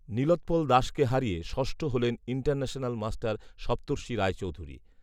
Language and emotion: Bengali, neutral